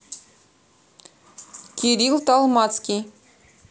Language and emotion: Russian, neutral